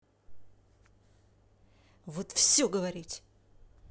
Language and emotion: Russian, angry